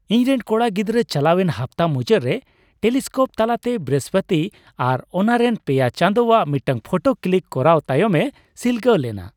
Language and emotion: Santali, happy